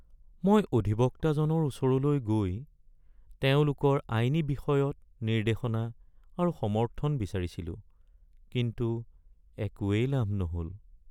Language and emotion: Assamese, sad